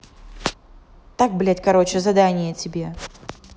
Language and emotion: Russian, angry